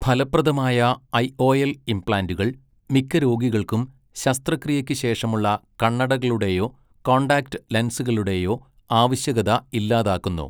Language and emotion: Malayalam, neutral